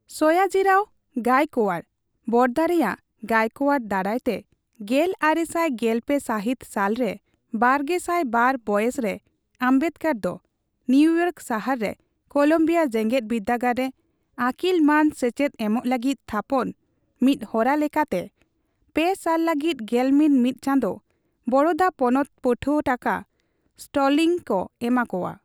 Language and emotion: Santali, neutral